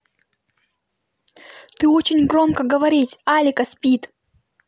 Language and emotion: Russian, angry